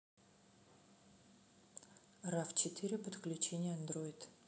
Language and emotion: Russian, neutral